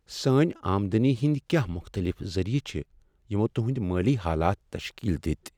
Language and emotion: Kashmiri, sad